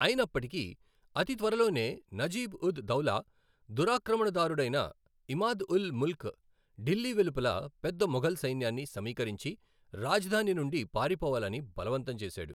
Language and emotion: Telugu, neutral